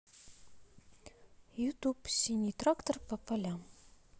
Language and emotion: Russian, neutral